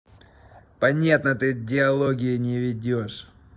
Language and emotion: Russian, angry